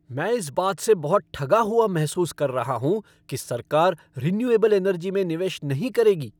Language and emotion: Hindi, angry